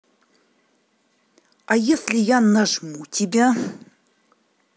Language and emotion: Russian, angry